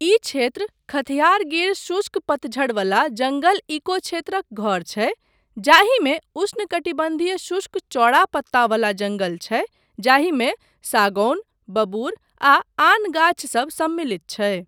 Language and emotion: Maithili, neutral